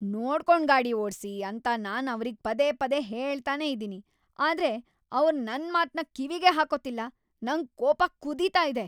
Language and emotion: Kannada, angry